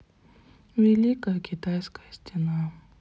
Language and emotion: Russian, sad